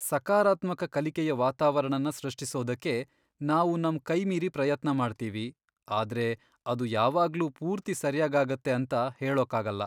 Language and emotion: Kannada, sad